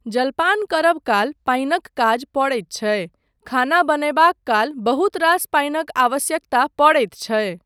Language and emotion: Maithili, neutral